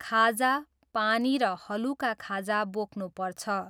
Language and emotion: Nepali, neutral